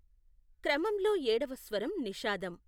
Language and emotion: Telugu, neutral